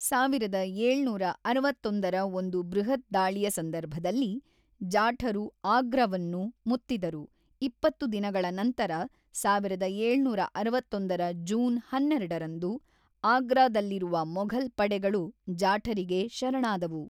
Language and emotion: Kannada, neutral